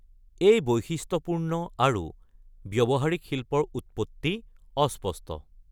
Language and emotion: Assamese, neutral